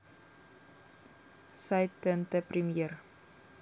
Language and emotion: Russian, neutral